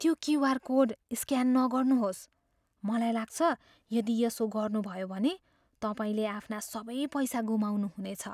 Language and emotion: Nepali, fearful